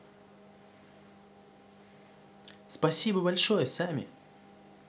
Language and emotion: Russian, positive